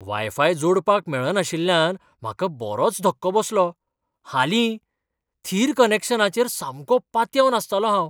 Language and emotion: Goan Konkani, surprised